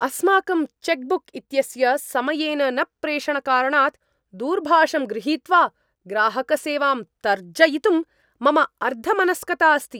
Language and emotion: Sanskrit, angry